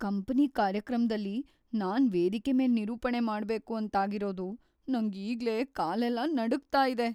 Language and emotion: Kannada, fearful